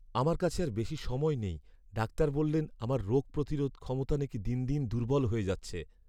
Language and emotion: Bengali, sad